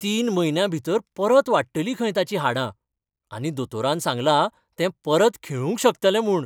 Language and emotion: Goan Konkani, happy